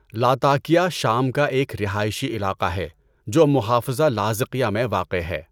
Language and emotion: Urdu, neutral